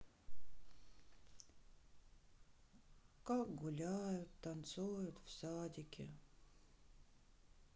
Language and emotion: Russian, sad